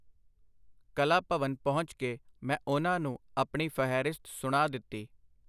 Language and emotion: Punjabi, neutral